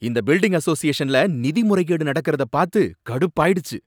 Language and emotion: Tamil, angry